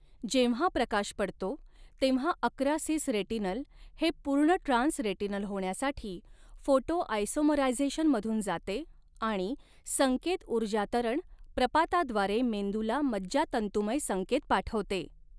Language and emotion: Marathi, neutral